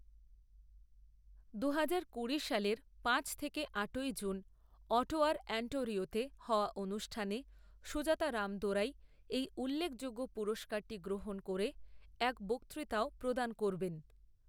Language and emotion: Bengali, neutral